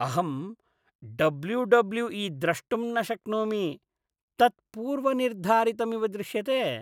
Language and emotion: Sanskrit, disgusted